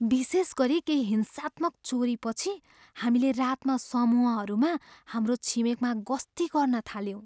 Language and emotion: Nepali, fearful